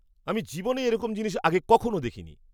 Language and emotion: Bengali, surprised